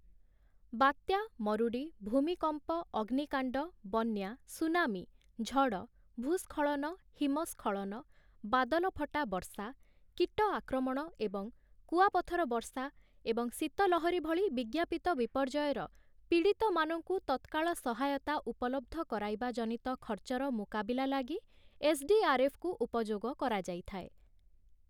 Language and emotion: Odia, neutral